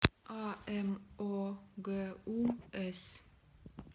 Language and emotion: Russian, neutral